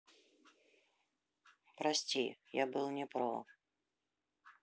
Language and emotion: Russian, sad